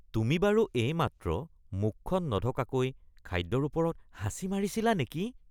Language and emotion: Assamese, disgusted